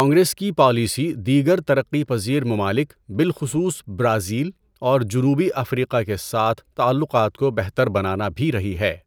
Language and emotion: Urdu, neutral